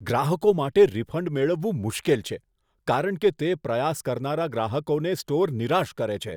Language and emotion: Gujarati, disgusted